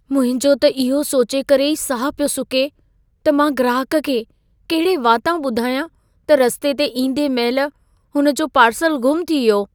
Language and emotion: Sindhi, fearful